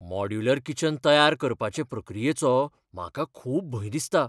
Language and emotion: Goan Konkani, fearful